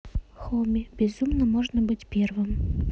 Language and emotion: Russian, neutral